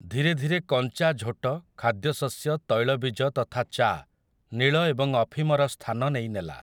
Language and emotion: Odia, neutral